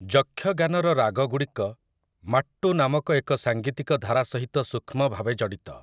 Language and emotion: Odia, neutral